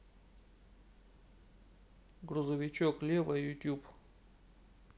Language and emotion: Russian, neutral